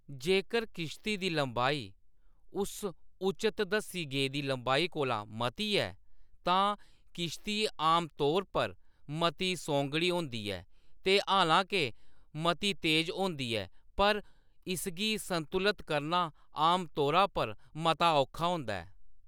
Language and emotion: Dogri, neutral